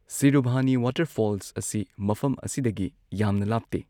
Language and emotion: Manipuri, neutral